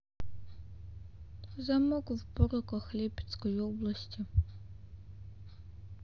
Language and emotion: Russian, neutral